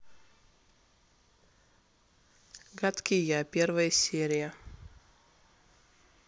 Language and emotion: Russian, neutral